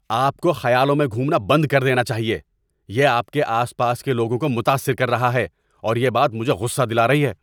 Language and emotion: Urdu, angry